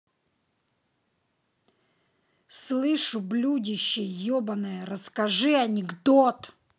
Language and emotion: Russian, angry